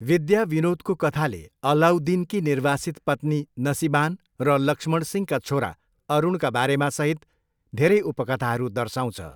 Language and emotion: Nepali, neutral